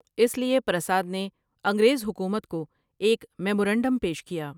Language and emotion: Urdu, neutral